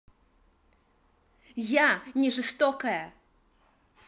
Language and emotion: Russian, angry